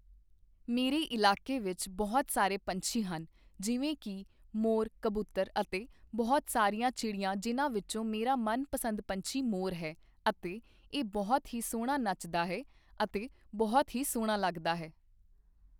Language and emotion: Punjabi, neutral